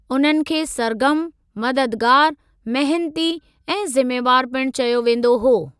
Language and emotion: Sindhi, neutral